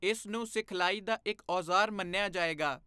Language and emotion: Punjabi, neutral